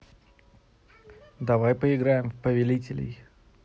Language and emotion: Russian, neutral